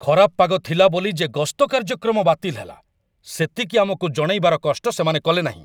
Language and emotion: Odia, angry